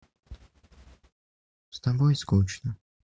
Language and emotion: Russian, sad